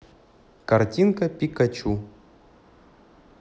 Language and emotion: Russian, neutral